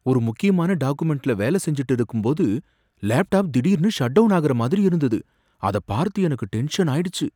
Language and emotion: Tamil, fearful